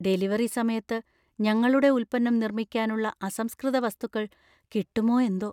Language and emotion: Malayalam, fearful